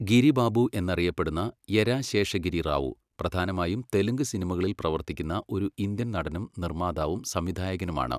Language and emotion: Malayalam, neutral